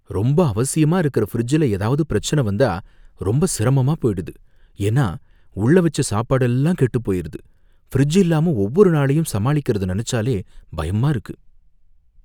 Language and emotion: Tamil, fearful